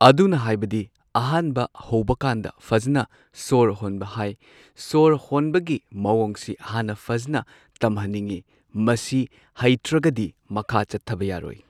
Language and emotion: Manipuri, neutral